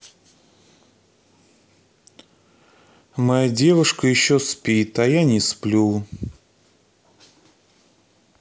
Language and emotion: Russian, sad